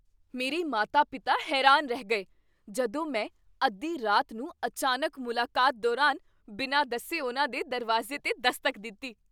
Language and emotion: Punjabi, surprised